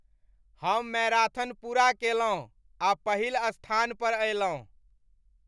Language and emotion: Maithili, happy